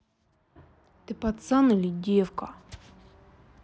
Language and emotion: Russian, angry